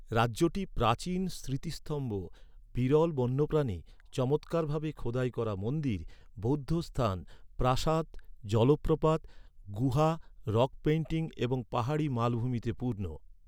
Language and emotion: Bengali, neutral